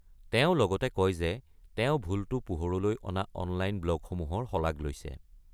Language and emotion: Assamese, neutral